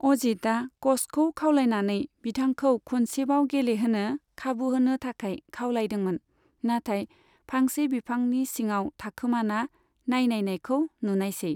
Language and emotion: Bodo, neutral